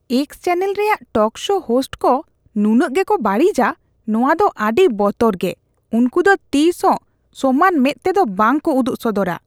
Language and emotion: Santali, disgusted